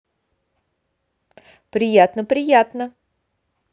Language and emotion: Russian, positive